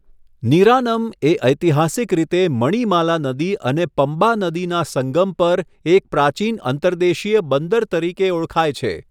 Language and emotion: Gujarati, neutral